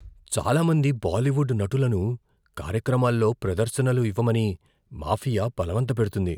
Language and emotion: Telugu, fearful